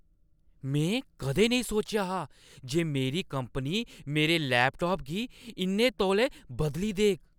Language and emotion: Dogri, surprised